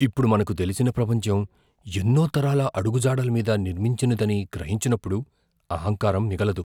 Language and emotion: Telugu, fearful